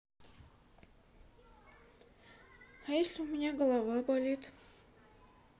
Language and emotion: Russian, sad